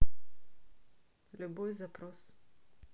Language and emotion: Russian, neutral